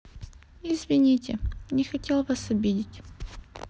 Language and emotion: Russian, sad